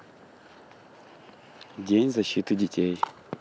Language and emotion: Russian, neutral